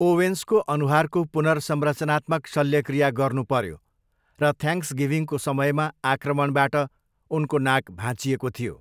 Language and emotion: Nepali, neutral